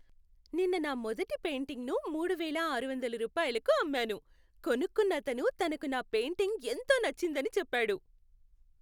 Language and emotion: Telugu, happy